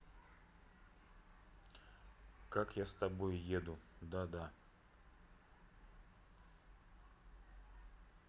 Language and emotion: Russian, neutral